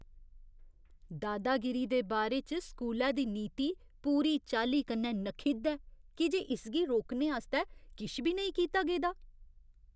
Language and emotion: Dogri, disgusted